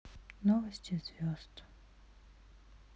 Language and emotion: Russian, sad